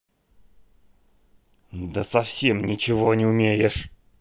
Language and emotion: Russian, angry